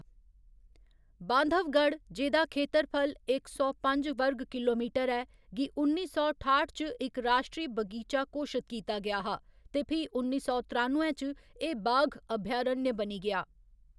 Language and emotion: Dogri, neutral